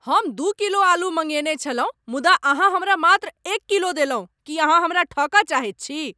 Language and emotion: Maithili, angry